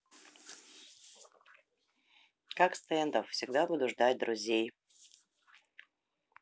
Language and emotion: Russian, positive